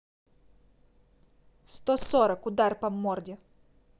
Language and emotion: Russian, angry